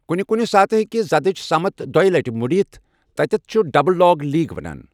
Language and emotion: Kashmiri, neutral